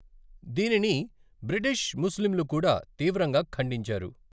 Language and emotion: Telugu, neutral